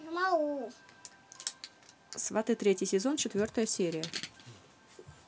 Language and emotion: Russian, neutral